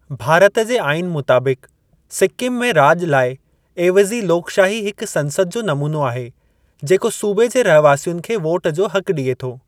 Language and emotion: Sindhi, neutral